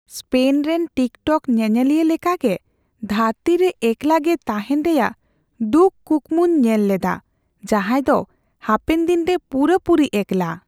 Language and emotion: Santali, fearful